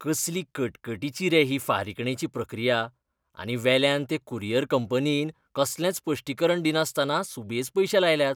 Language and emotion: Goan Konkani, disgusted